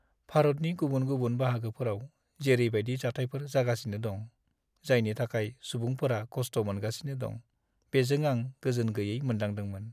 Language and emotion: Bodo, sad